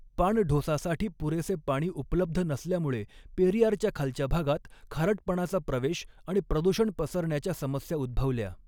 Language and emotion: Marathi, neutral